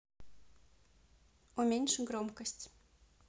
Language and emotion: Russian, neutral